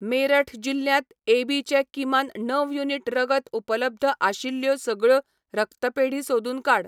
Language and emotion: Goan Konkani, neutral